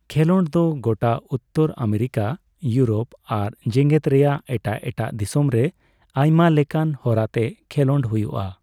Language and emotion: Santali, neutral